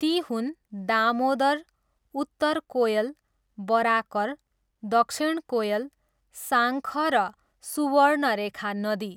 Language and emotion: Nepali, neutral